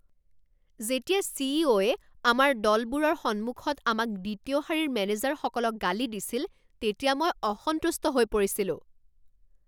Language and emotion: Assamese, angry